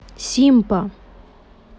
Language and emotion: Russian, neutral